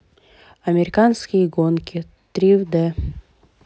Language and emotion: Russian, neutral